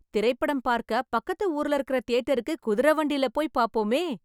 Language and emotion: Tamil, happy